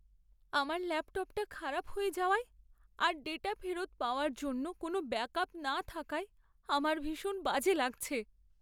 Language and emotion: Bengali, sad